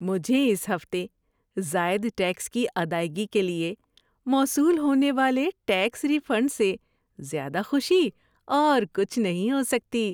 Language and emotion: Urdu, happy